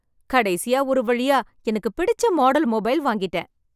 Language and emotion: Tamil, happy